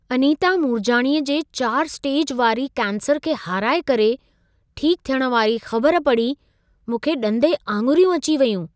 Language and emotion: Sindhi, surprised